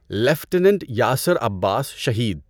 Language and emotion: Urdu, neutral